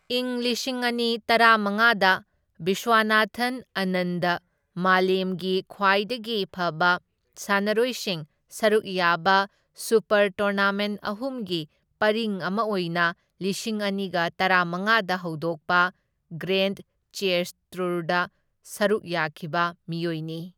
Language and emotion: Manipuri, neutral